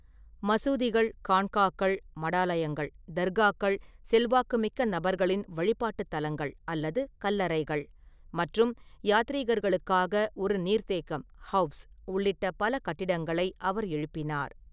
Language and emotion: Tamil, neutral